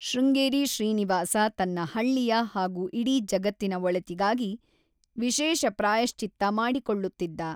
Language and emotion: Kannada, neutral